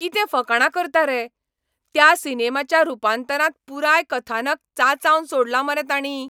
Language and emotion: Goan Konkani, angry